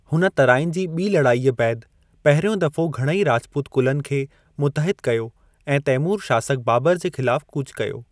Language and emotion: Sindhi, neutral